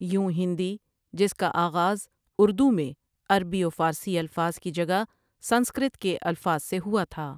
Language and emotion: Urdu, neutral